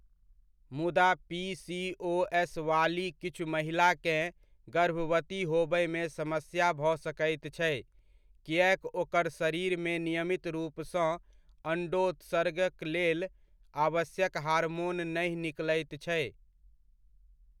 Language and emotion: Maithili, neutral